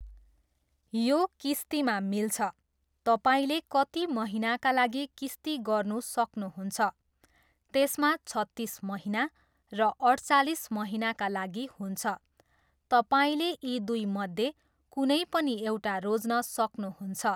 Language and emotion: Nepali, neutral